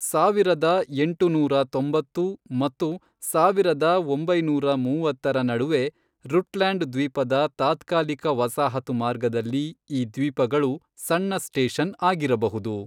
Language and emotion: Kannada, neutral